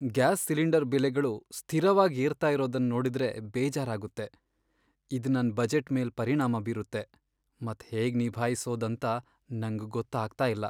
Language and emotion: Kannada, sad